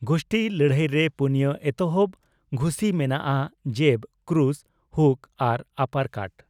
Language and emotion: Santali, neutral